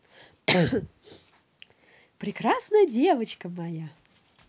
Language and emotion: Russian, positive